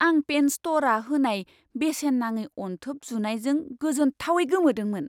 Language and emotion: Bodo, surprised